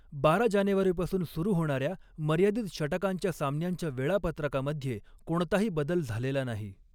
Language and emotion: Marathi, neutral